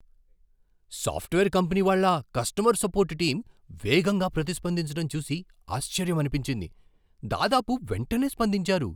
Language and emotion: Telugu, surprised